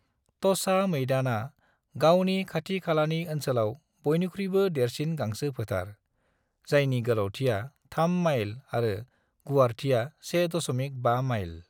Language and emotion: Bodo, neutral